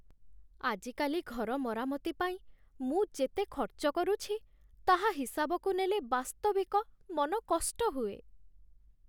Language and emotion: Odia, sad